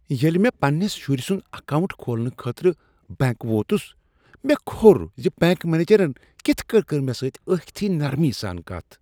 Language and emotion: Kashmiri, disgusted